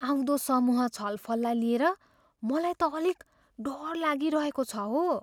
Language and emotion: Nepali, fearful